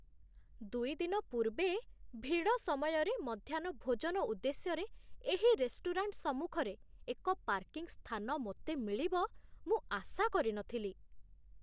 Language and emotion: Odia, surprised